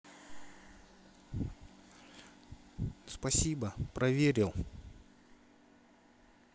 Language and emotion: Russian, neutral